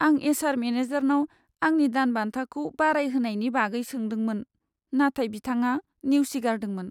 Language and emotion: Bodo, sad